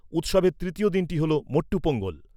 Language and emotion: Bengali, neutral